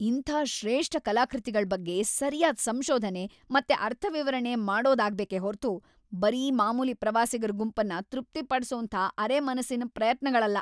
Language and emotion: Kannada, angry